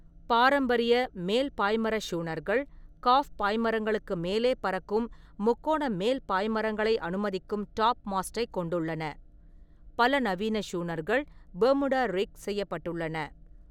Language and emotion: Tamil, neutral